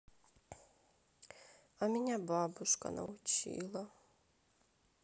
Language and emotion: Russian, sad